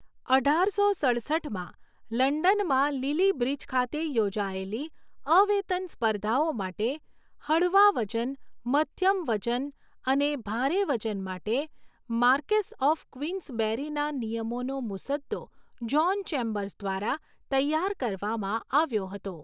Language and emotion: Gujarati, neutral